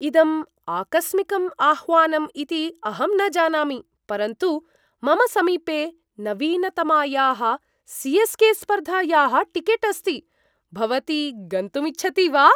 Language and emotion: Sanskrit, surprised